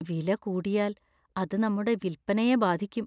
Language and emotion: Malayalam, fearful